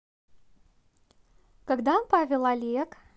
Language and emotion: Russian, neutral